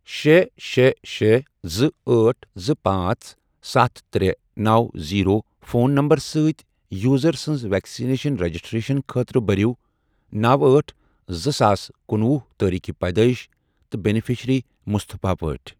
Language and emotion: Kashmiri, neutral